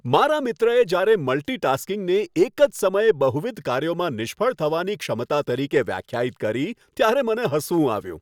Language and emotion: Gujarati, happy